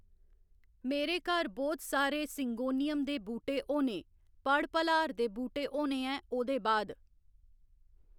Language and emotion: Dogri, neutral